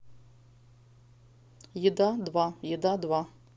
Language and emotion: Russian, neutral